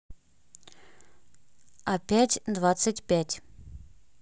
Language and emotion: Russian, neutral